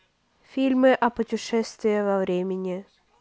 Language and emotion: Russian, neutral